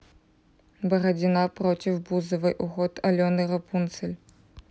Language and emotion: Russian, neutral